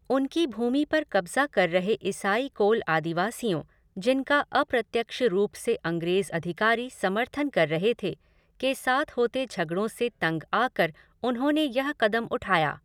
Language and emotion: Hindi, neutral